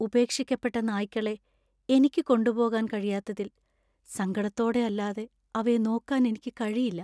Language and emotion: Malayalam, sad